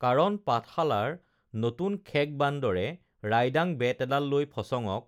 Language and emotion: Assamese, neutral